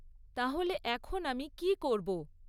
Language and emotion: Bengali, neutral